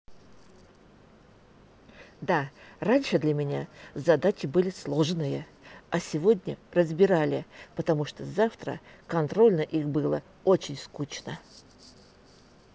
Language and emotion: Russian, positive